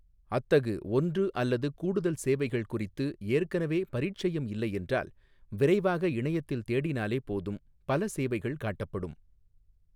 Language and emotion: Tamil, neutral